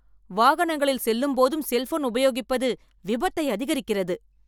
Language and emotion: Tamil, angry